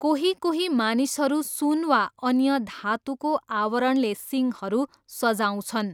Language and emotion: Nepali, neutral